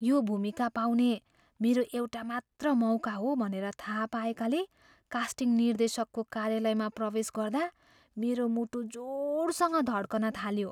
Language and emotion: Nepali, fearful